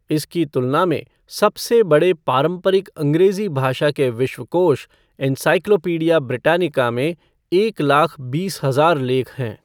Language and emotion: Hindi, neutral